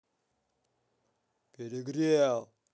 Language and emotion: Russian, angry